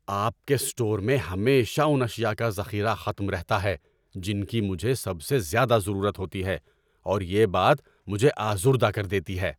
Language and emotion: Urdu, angry